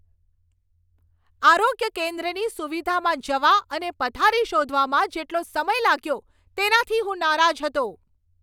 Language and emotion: Gujarati, angry